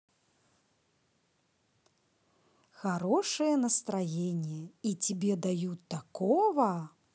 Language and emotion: Russian, positive